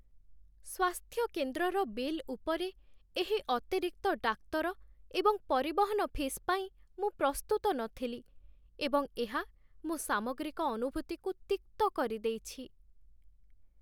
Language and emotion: Odia, sad